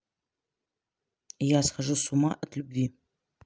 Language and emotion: Russian, neutral